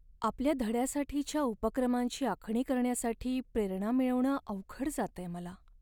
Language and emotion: Marathi, sad